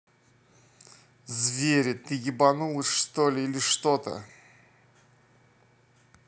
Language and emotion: Russian, angry